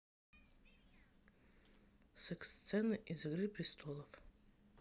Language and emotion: Russian, neutral